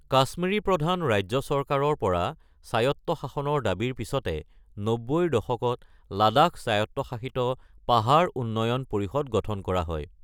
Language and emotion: Assamese, neutral